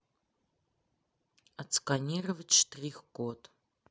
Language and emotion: Russian, neutral